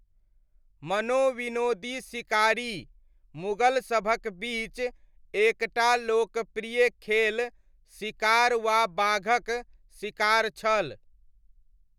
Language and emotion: Maithili, neutral